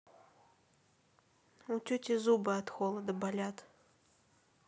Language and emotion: Russian, sad